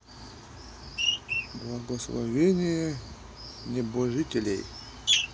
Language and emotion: Russian, neutral